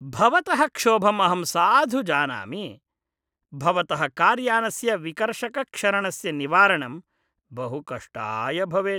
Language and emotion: Sanskrit, disgusted